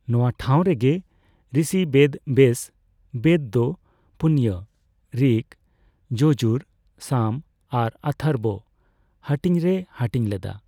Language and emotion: Santali, neutral